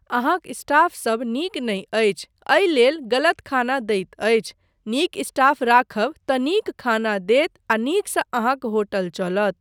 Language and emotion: Maithili, neutral